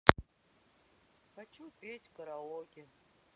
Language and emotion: Russian, sad